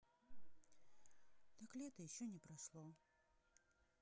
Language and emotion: Russian, sad